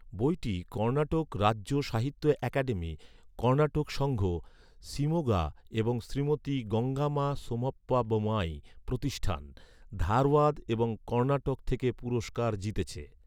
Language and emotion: Bengali, neutral